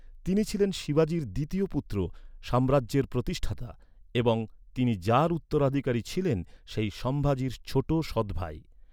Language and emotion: Bengali, neutral